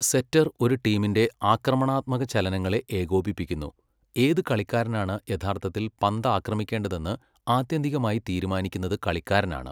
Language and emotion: Malayalam, neutral